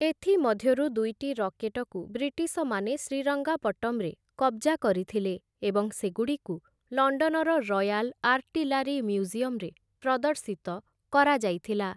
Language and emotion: Odia, neutral